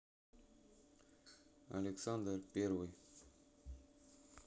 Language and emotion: Russian, neutral